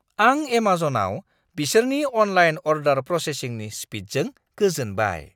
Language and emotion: Bodo, surprised